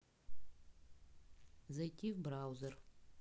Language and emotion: Russian, neutral